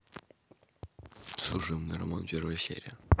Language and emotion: Russian, neutral